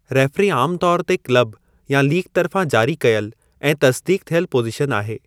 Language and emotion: Sindhi, neutral